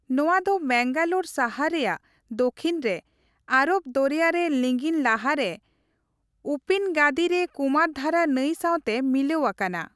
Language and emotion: Santali, neutral